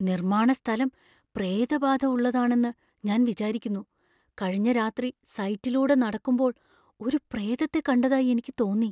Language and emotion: Malayalam, fearful